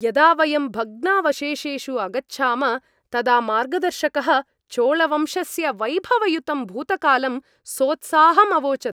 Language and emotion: Sanskrit, happy